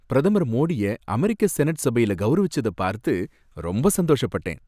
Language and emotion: Tamil, happy